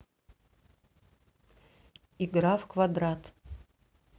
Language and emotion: Russian, neutral